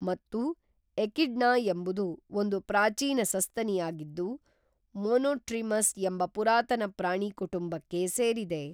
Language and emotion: Kannada, neutral